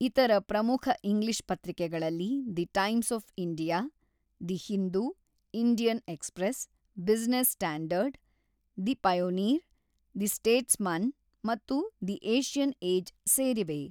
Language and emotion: Kannada, neutral